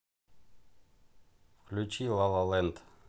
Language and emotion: Russian, neutral